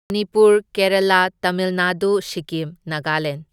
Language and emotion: Manipuri, neutral